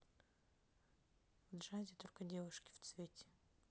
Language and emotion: Russian, neutral